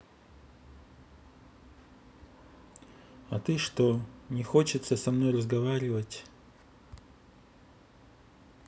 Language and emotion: Russian, neutral